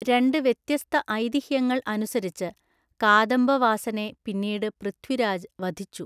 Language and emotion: Malayalam, neutral